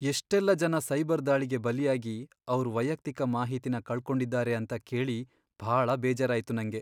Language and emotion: Kannada, sad